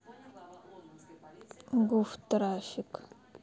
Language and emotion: Russian, neutral